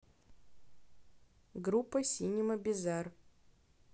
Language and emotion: Russian, neutral